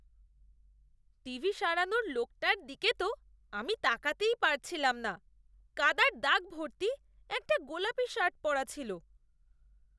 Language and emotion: Bengali, disgusted